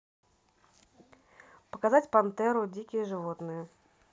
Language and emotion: Russian, neutral